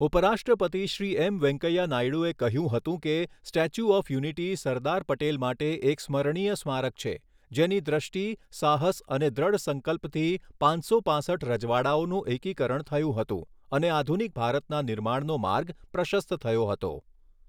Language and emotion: Gujarati, neutral